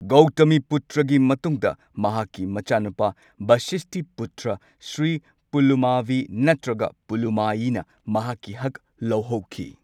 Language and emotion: Manipuri, neutral